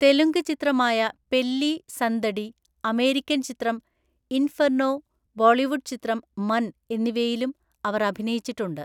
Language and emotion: Malayalam, neutral